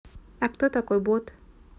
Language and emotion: Russian, neutral